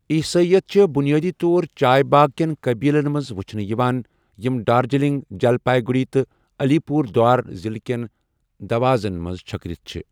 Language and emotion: Kashmiri, neutral